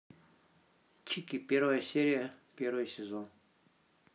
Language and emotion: Russian, neutral